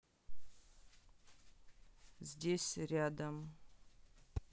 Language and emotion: Russian, neutral